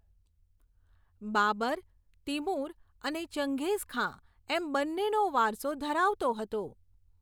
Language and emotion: Gujarati, neutral